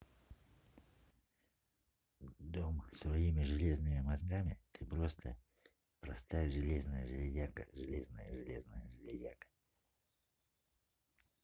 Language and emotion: Russian, neutral